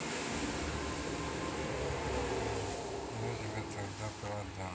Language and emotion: Russian, neutral